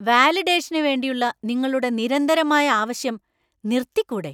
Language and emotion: Malayalam, angry